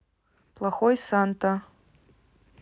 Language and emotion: Russian, neutral